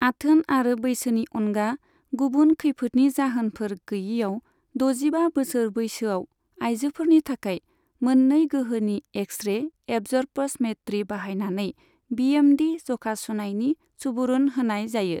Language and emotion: Bodo, neutral